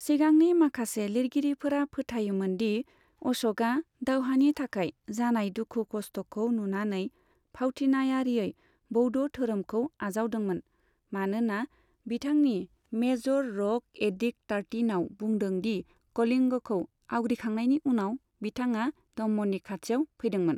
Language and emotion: Bodo, neutral